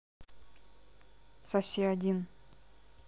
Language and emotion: Russian, neutral